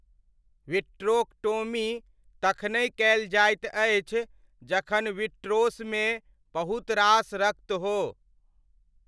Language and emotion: Maithili, neutral